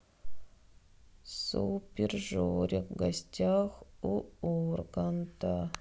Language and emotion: Russian, sad